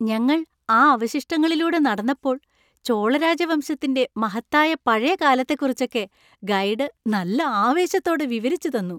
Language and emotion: Malayalam, happy